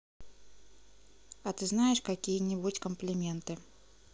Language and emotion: Russian, neutral